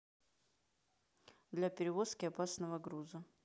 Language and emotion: Russian, neutral